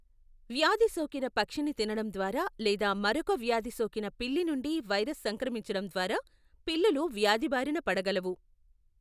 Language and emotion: Telugu, neutral